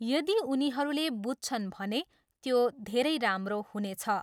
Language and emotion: Nepali, neutral